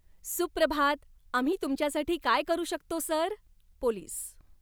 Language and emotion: Marathi, happy